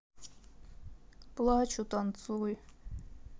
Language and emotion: Russian, sad